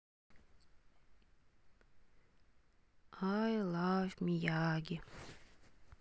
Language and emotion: Russian, neutral